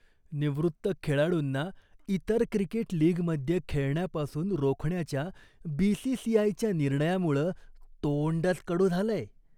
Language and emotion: Marathi, disgusted